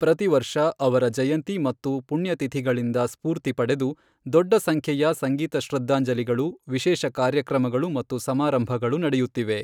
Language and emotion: Kannada, neutral